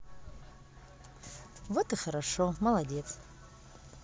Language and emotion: Russian, positive